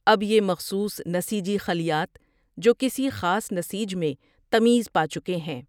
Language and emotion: Urdu, neutral